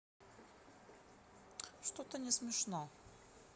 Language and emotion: Russian, neutral